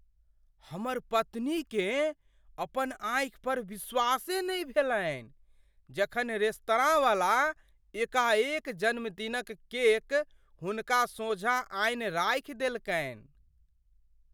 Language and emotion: Maithili, surprised